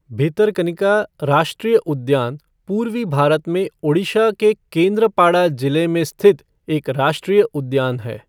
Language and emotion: Hindi, neutral